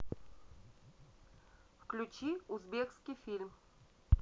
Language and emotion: Russian, neutral